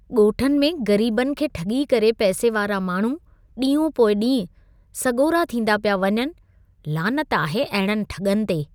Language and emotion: Sindhi, disgusted